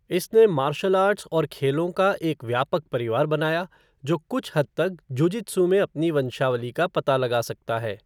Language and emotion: Hindi, neutral